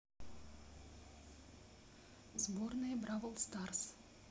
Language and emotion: Russian, neutral